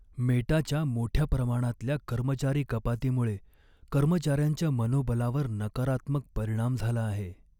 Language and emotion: Marathi, sad